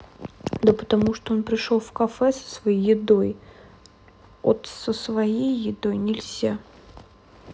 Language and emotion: Russian, sad